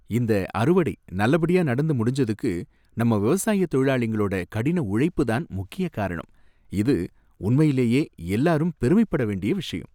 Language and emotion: Tamil, happy